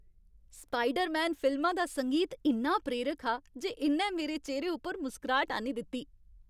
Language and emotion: Dogri, happy